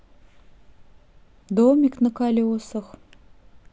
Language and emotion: Russian, sad